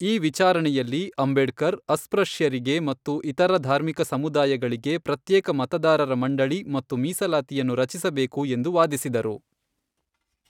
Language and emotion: Kannada, neutral